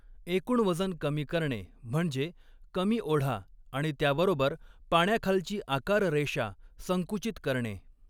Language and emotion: Marathi, neutral